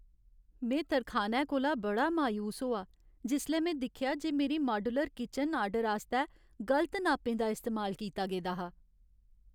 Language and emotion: Dogri, sad